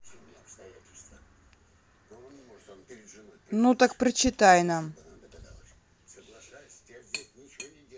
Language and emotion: Russian, neutral